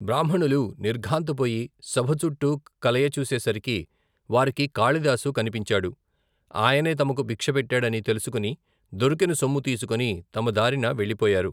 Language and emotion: Telugu, neutral